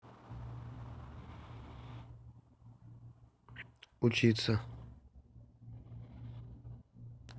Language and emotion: Russian, neutral